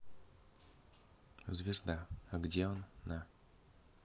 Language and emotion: Russian, neutral